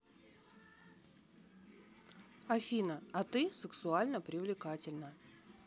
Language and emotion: Russian, neutral